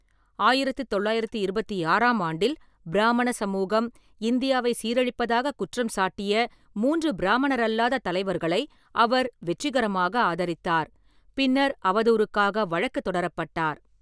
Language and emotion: Tamil, neutral